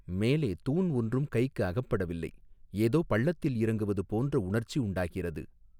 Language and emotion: Tamil, neutral